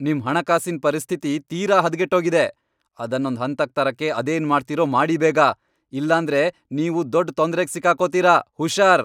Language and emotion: Kannada, angry